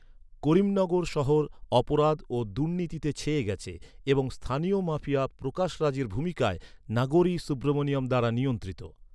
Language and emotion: Bengali, neutral